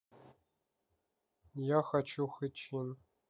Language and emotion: Russian, neutral